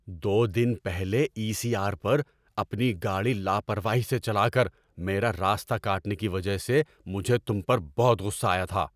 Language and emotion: Urdu, angry